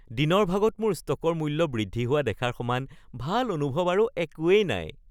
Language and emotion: Assamese, happy